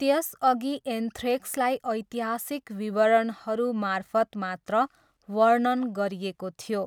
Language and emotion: Nepali, neutral